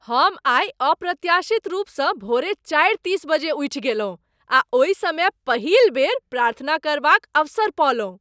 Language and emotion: Maithili, surprised